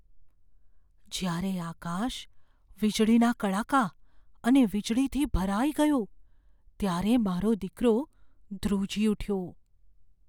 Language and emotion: Gujarati, fearful